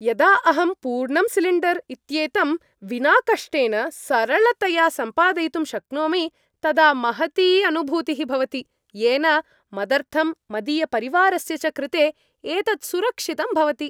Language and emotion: Sanskrit, happy